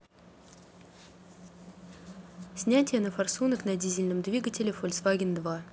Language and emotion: Russian, neutral